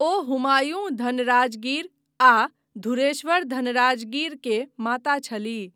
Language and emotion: Maithili, neutral